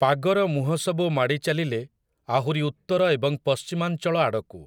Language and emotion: Odia, neutral